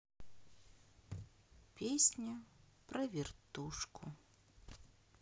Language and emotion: Russian, sad